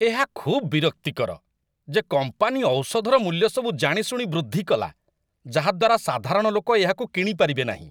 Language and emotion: Odia, disgusted